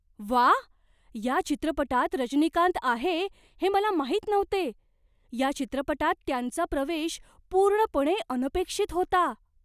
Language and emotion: Marathi, surprised